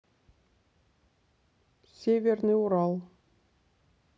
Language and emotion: Russian, neutral